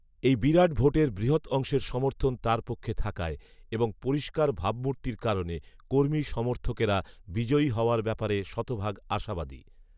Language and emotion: Bengali, neutral